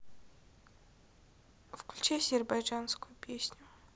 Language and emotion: Russian, sad